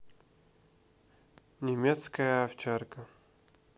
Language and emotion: Russian, neutral